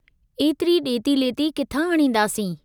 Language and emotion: Sindhi, neutral